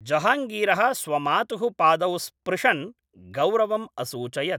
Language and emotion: Sanskrit, neutral